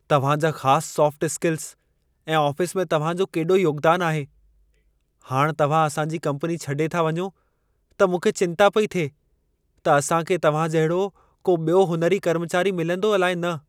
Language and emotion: Sindhi, fearful